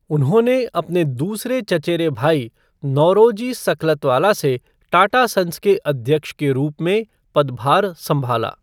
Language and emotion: Hindi, neutral